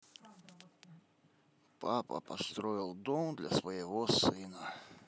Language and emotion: Russian, neutral